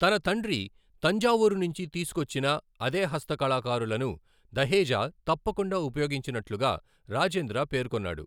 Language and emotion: Telugu, neutral